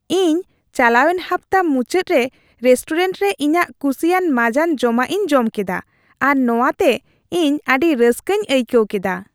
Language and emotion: Santali, happy